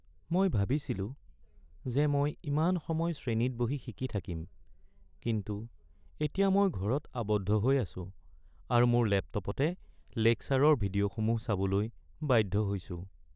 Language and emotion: Assamese, sad